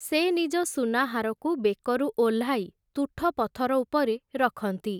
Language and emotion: Odia, neutral